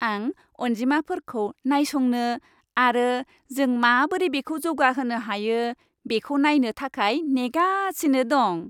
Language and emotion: Bodo, happy